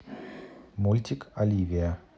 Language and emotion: Russian, neutral